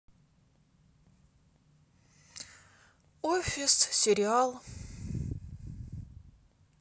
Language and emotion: Russian, sad